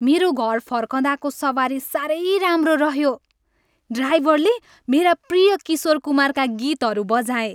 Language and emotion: Nepali, happy